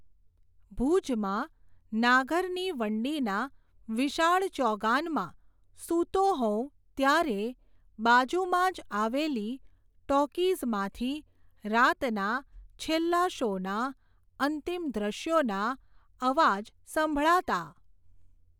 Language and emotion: Gujarati, neutral